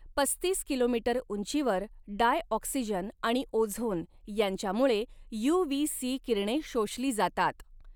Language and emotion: Marathi, neutral